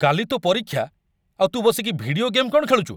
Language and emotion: Odia, angry